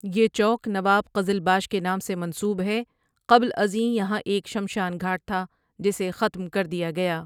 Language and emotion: Urdu, neutral